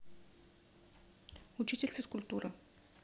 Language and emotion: Russian, neutral